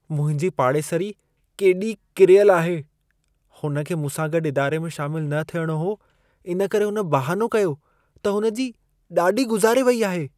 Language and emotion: Sindhi, disgusted